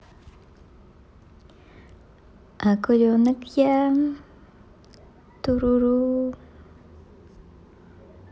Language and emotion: Russian, positive